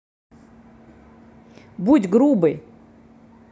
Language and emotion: Russian, angry